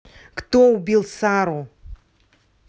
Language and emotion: Russian, angry